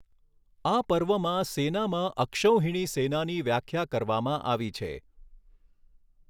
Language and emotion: Gujarati, neutral